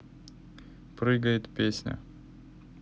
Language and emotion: Russian, neutral